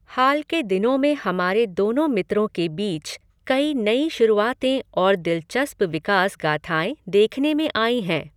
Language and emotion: Hindi, neutral